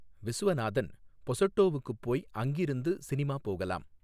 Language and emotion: Tamil, neutral